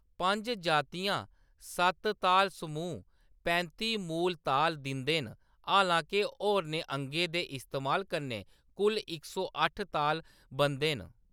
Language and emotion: Dogri, neutral